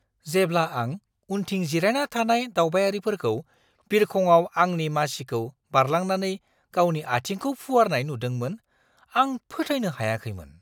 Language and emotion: Bodo, surprised